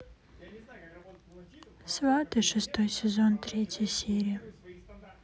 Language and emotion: Russian, sad